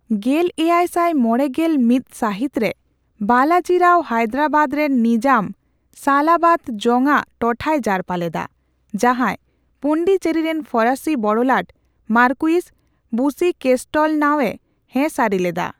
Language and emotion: Santali, neutral